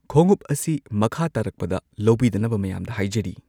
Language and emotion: Manipuri, neutral